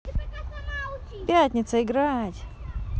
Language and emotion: Russian, positive